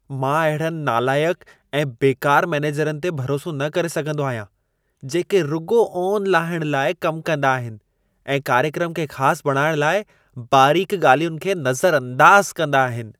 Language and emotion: Sindhi, disgusted